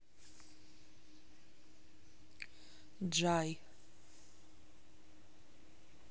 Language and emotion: Russian, neutral